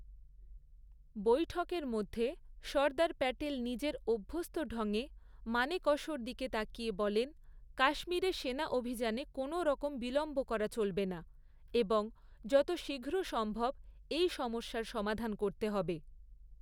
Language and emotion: Bengali, neutral